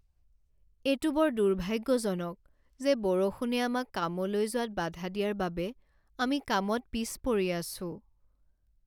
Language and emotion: Assamese, sad